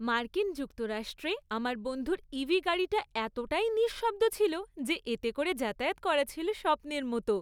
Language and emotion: Bengali, happy